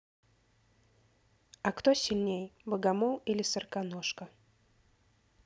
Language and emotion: Russian, neutral